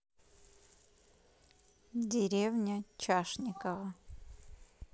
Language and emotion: Russian, neutral